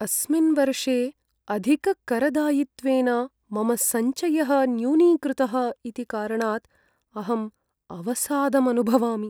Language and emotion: Sanskrit, sad